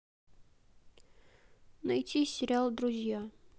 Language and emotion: Russian, neutral